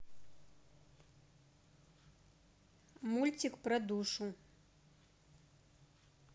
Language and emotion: Russian, neutral